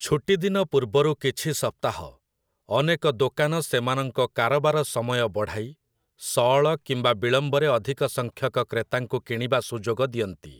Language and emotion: Odia, neutral